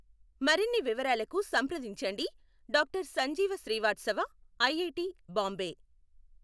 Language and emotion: Telugu, neutral